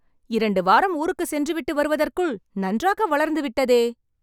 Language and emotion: Tamil, happy